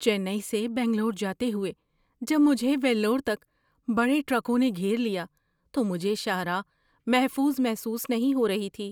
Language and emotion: Urdu, fearful